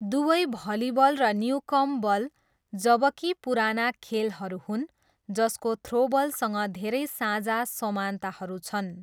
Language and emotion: Nepali, neutral